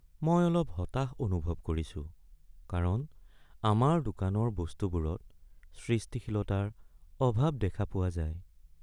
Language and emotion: Assamese, sad